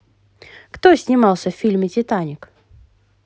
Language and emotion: Russian, positive